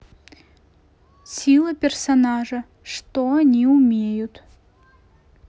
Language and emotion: Russian, neutral